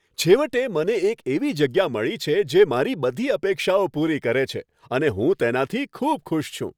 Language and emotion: Gujarati, happy